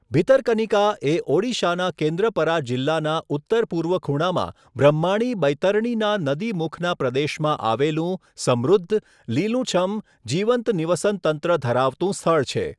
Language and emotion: Gujarati, neutral